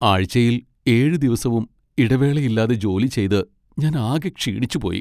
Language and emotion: Malayalam, sad